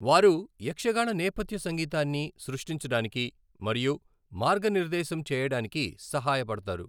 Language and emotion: Telugu, neutral